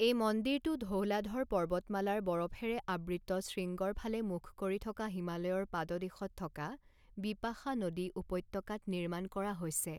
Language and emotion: Assamese, neutral